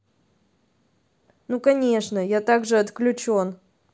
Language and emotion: Russian, neutral